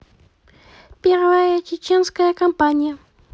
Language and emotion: Russian, positive